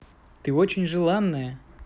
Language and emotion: Russian, positive